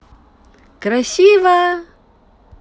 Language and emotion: Russian, positive